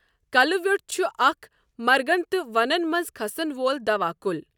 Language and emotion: Kashmiri, neutral